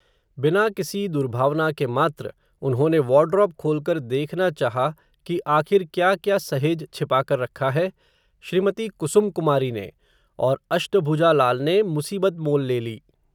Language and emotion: Hindi, neutral